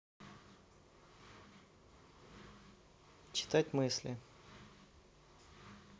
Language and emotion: Russian, neutral